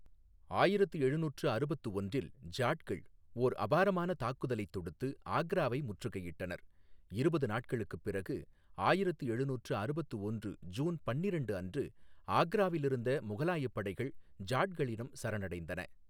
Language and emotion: Tamil, neutral